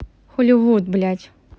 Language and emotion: Russian, angry